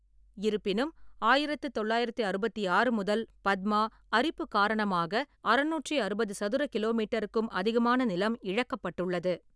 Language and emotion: Tamil, neutral